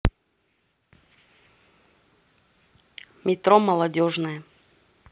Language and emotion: Russian, neutral